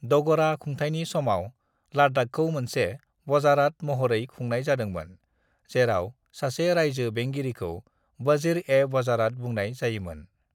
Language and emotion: Bodo, neutral